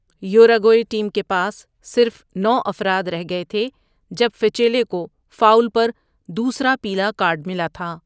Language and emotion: Urdu, neutral